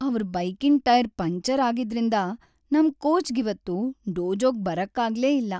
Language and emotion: Kannada, sad